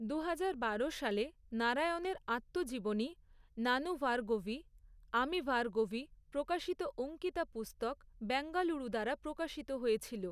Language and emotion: Bengali, neutral